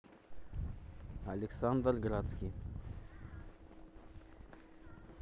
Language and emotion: Russian, neutral